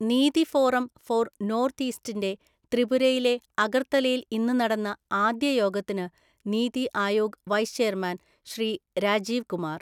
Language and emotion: Malayalam, neutral